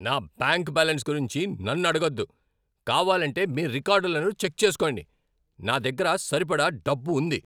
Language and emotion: Telugu, angry